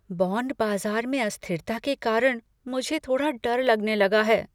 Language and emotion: Hindi, fearful